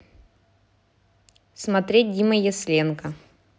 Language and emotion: Russian, neutral